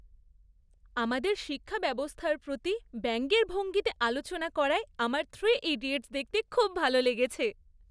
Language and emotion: Bengali, happy